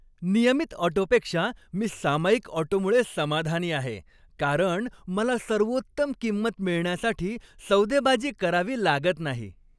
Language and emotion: Marathi, happy